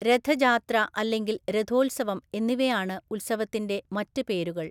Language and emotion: Malayalam, neutral